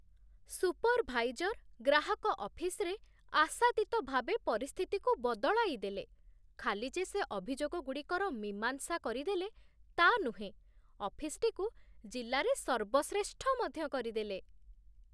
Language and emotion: Odia, surprised